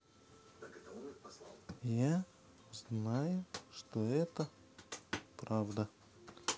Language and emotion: Russian, neutral